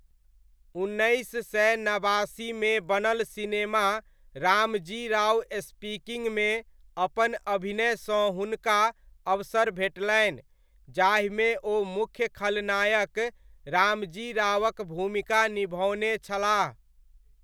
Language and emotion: Maithili, neutral